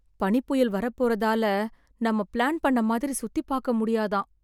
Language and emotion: Tamil, sad